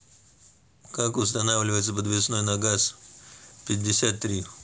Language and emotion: Russian, neutral